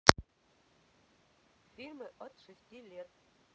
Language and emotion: Russian, neutral